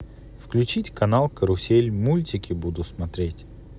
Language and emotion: Russian, neutral